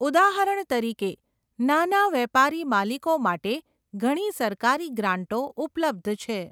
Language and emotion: Gujarati, neutral